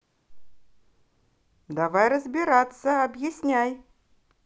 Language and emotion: Russian, positive